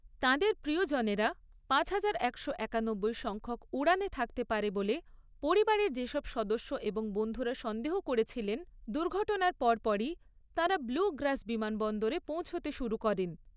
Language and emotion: Bengali, neutral